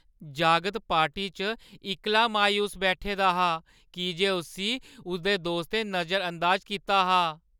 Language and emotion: Dogri, sad